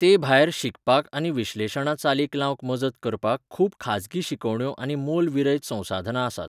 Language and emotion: Goan Konkani, neutral